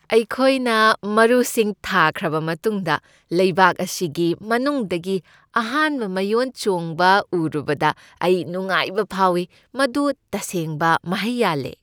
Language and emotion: Manipuri, happy